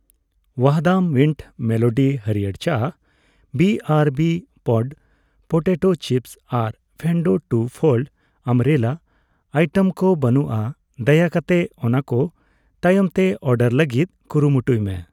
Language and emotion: Santali, neutral